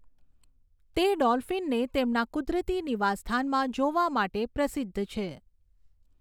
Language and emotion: Gujarati, neutral